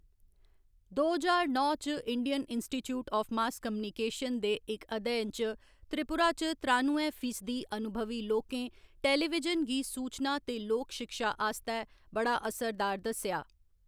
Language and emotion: Dogri, neutral